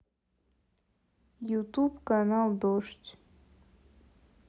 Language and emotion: Russian, sad